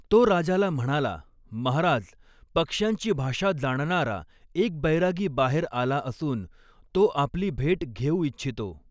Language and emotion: Marathi, neutral